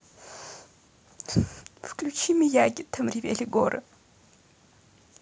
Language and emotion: Russian, sad